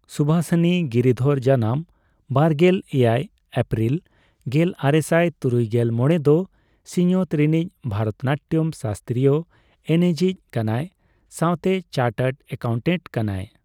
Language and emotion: Santali, neutral